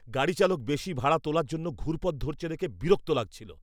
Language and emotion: Bengali, angry